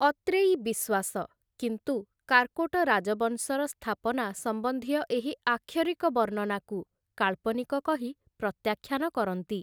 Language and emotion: Odia, neutral